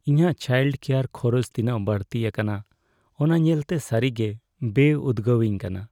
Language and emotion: Santali, sad